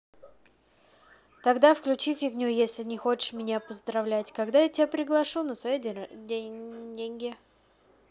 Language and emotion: Russian, neutral